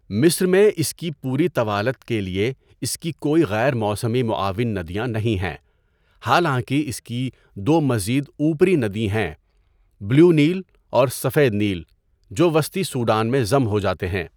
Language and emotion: Urdu, neutral